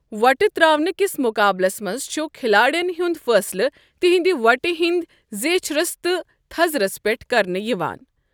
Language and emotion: Kashmiri, neutral